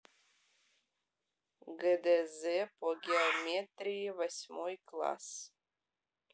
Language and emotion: Russian, neutral